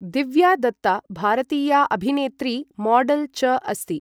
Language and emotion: Sanskrit, neutral